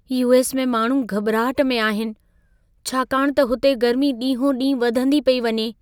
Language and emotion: Sindhi, fearful